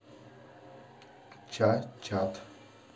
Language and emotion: Russian, neutral